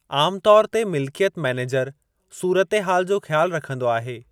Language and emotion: Sindhi, neutral